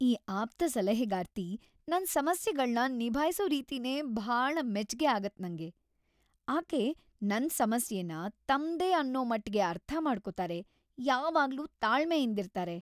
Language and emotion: Kannada, happy